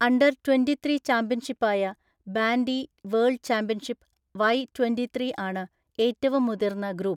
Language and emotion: Malayalam, neutral